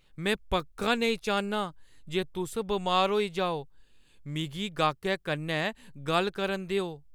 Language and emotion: Dogri, fearful